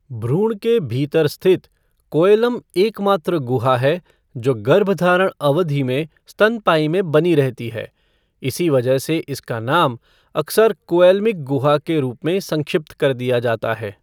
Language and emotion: Hindi, neutral